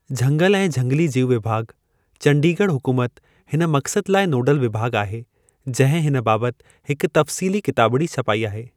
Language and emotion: Sindhi, neutral